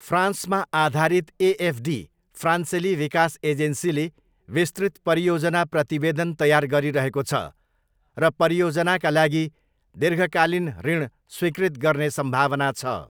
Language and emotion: Nepali, neutral